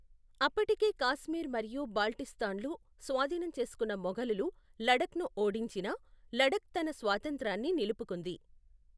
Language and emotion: Telugu, neutral